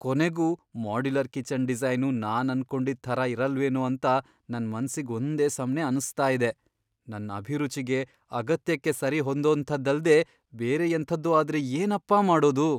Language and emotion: Kannada, fearful